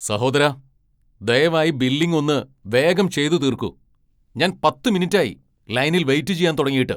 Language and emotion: Malayalam, angry